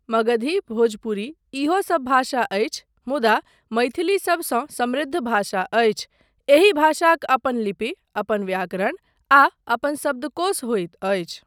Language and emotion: Maithili, neutral